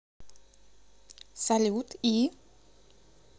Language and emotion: Russian, neutral